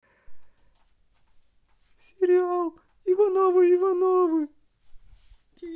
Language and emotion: Russian, sad